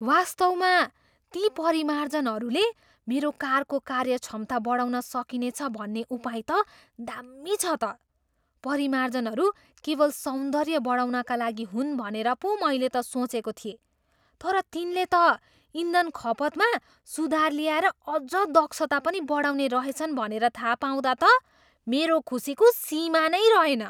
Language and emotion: Nepali, surprised